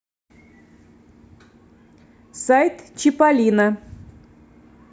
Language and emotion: Russian, neutral